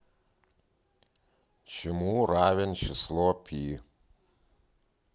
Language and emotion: Russian, neutral